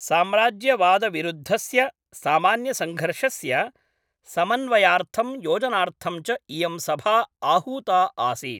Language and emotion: Sanskrit, neutral